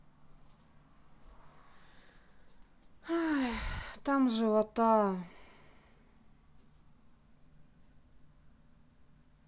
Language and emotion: Russian, sad